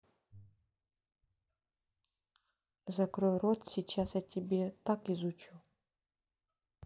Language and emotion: Russian, neutral